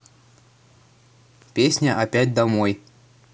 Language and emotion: Russian, neutral